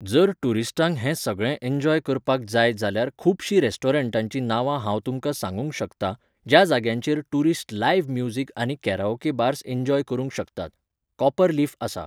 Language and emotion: Goan Konkani, neutral